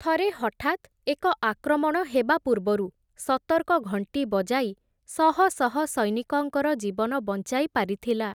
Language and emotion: Odia, neutral